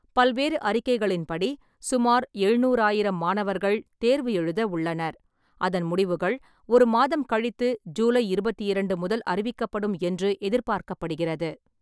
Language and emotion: Tamil, neutral